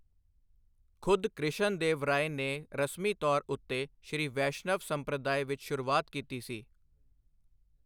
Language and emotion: Punjabi, neutral